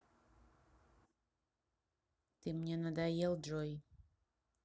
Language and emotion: Russian, neutral